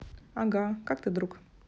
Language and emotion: Russian, neutral